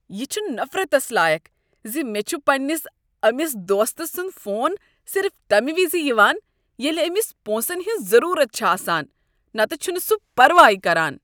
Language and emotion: Kashmiri, disgusted